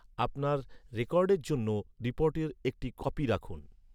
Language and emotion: Bengali, neutral